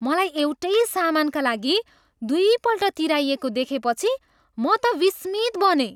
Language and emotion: Nepali, surprised